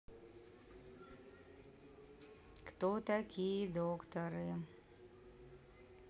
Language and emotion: Russian, neutral